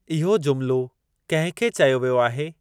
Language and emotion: Sindhi, neutral